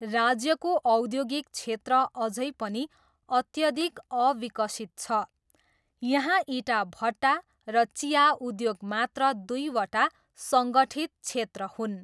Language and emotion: Nepali, neutral